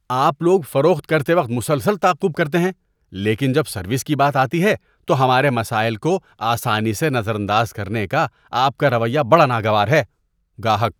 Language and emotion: Urdu, disgusted